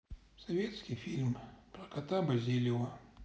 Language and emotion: Russian, sad